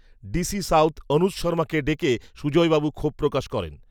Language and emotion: Bengali, neutral